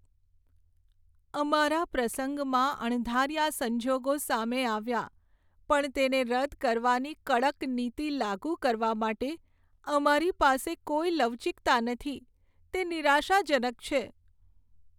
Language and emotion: Gujarati, sad